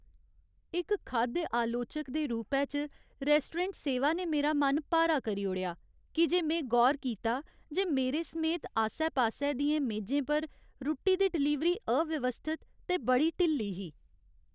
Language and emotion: Dogri, sad